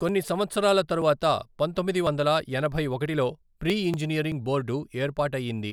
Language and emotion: Telugu, neutral